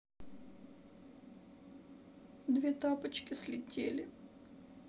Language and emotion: Russian, sad